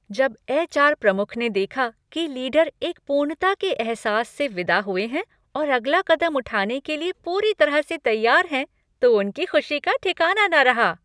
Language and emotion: Hindi, happy